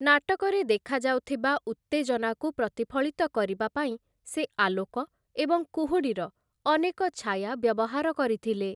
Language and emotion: Odia, neutral